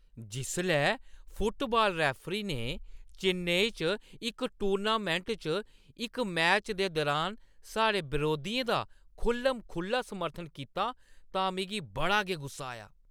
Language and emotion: Dogri, angry